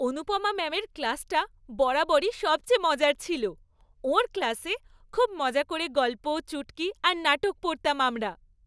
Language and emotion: Bengali, happy